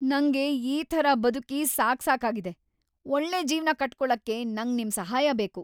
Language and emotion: Kannada, angry